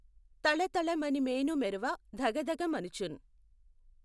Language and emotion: Telugu, neutral